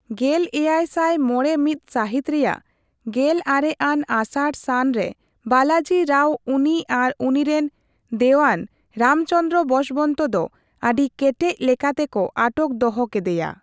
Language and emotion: Santali, neutral